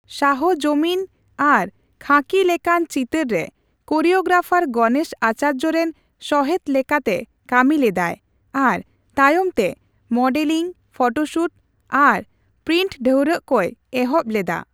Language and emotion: Santali, neutral